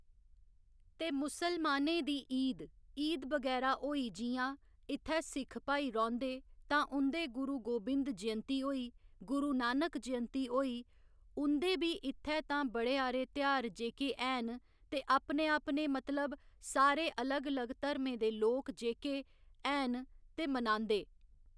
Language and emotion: Dogri, neutral